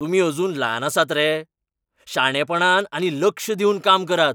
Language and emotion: Goan Konkani, angry